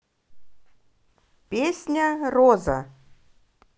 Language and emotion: Russian, positive